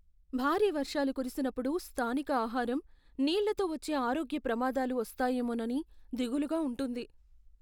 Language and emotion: Telugu, fearful